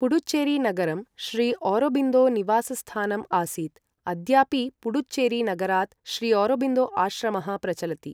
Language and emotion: Sanskrit, neutral